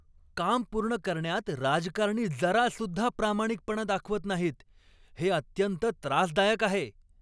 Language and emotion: Marathi, angry